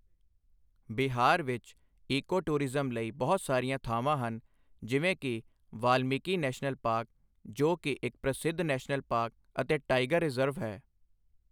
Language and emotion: Punjabi, neutral